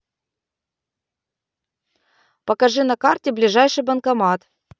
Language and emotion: Russian, positive